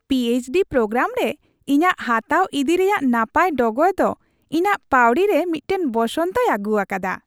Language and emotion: Santali, happy